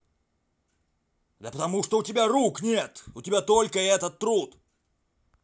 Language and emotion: Russian, angry